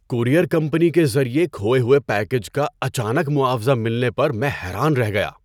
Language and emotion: Urdu, surprised